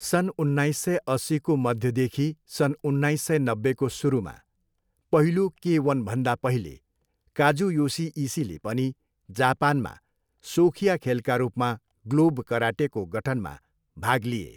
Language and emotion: Nepali, neutral